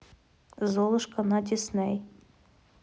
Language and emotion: Russian, neutral